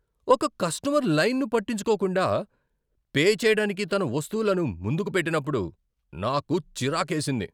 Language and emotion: Telugu, angry